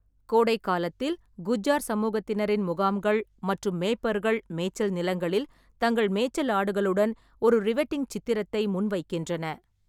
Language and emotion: Tamil, neutral